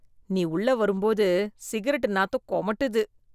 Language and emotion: Tamil, disgusted